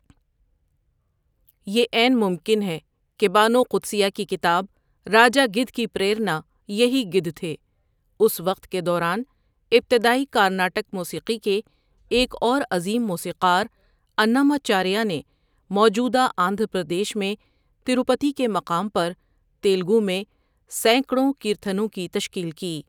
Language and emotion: Urdu, neutral